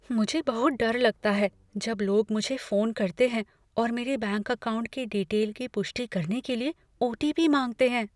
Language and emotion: Hindi, fearful